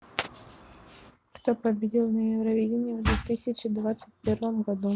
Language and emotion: Russian, neutral